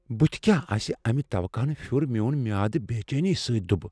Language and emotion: Kashmiri, fearful